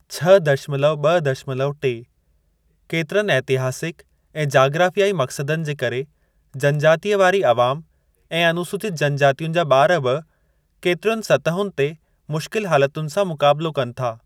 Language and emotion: Sindhi, neutral